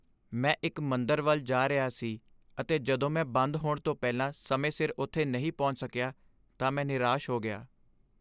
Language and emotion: Punjabi, sad